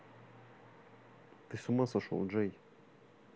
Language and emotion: Russian, neutral